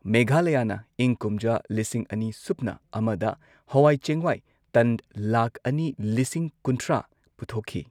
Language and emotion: Manipuri, neutral